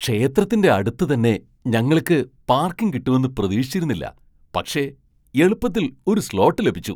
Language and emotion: Malayalam, surprised